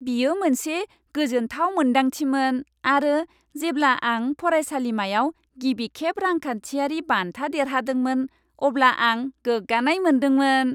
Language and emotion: Bodo, happy